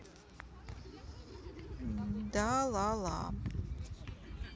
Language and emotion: Russian, neutral